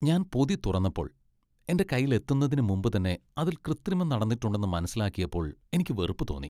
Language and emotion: Malayalam, disgusted